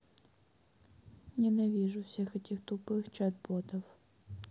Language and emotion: Russian, sad